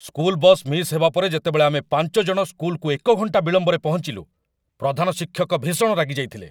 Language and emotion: Odia, angry